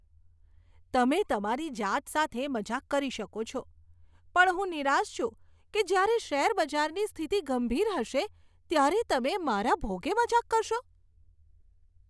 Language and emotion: Gujarati, disgusted